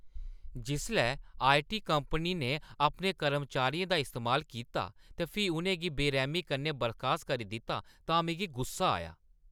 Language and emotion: Dogri, angry